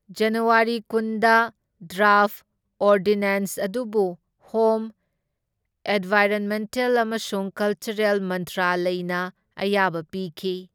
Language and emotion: Manipuri, neutral